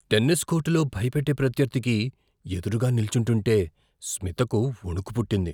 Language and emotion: Telugu, fearful